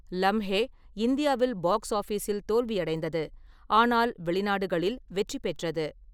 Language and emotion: Tamil, neutral